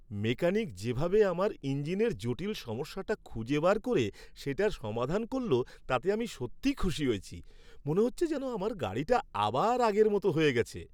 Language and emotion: Bengali, happy